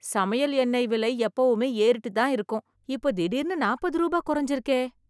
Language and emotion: Tamil, surprised